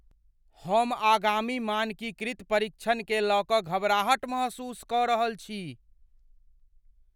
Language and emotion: Maithili, fearful